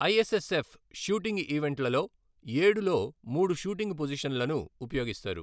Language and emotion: Telugu, neutral